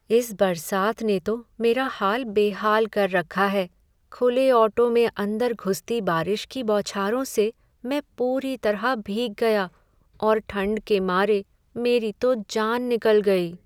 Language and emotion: Hindi, sad